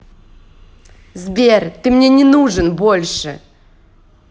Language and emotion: Russian, angry